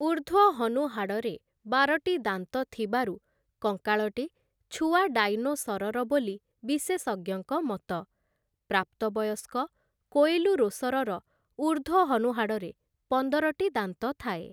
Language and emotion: Odia, neutral